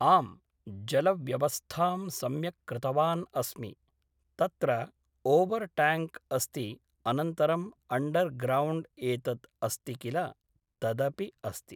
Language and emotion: Sanskrit, neutral